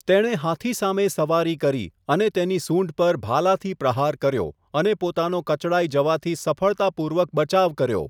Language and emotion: Gujarati, neutral